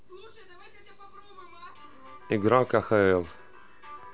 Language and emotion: Russian, neutral